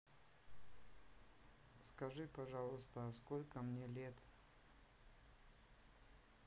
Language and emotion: Russian, neutral